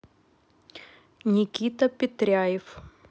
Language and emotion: Russian, neutral